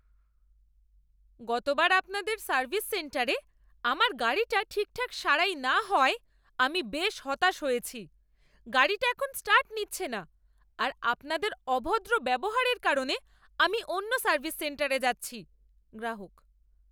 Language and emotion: Bengali, angry